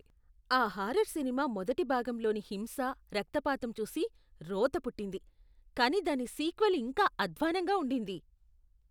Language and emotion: Telugu, disgusted